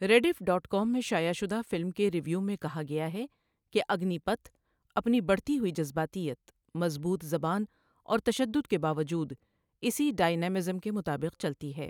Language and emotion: Urdu, neutral